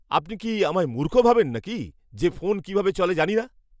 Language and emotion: Bengali, angry